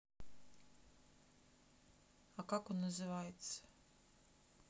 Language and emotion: Russian, neutral